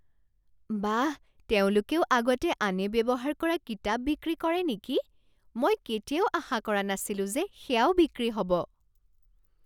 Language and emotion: Assamese, surprised